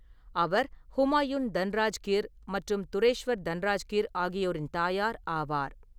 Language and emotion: Tamil, neutral